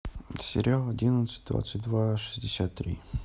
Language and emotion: Russian, neutral